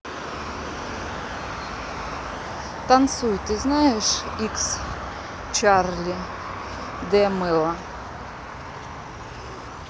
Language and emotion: Russian, neutral